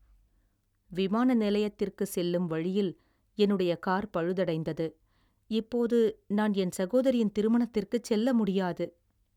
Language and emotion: Tamil, sad